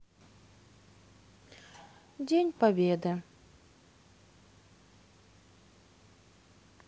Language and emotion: Russian, sad